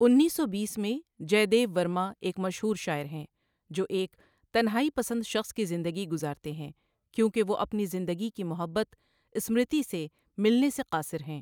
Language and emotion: Urdu, neutral